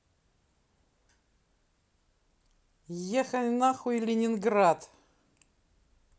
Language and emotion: Russian, neutral